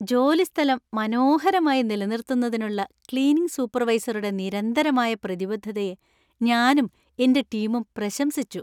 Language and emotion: Malayalam, happy